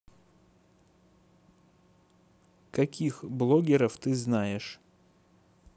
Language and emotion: Russian, neutral